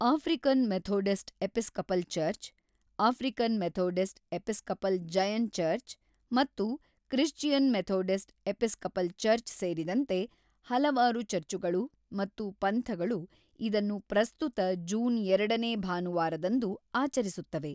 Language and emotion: Kannada, neutral